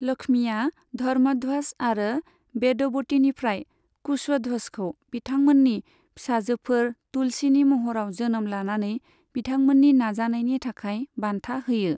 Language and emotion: Bodo, neutral